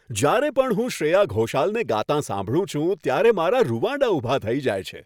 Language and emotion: Gujarati, happy